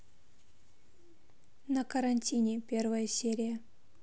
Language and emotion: Russian, neutral